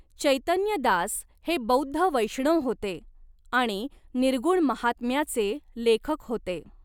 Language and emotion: Marathi, neutral